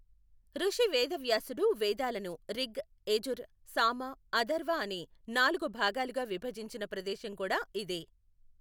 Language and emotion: Telugu, neutral